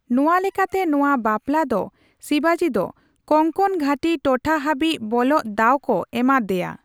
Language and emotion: Santali, neutral